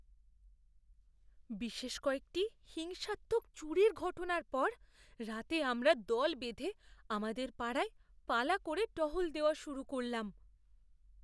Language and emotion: Bengali, fearful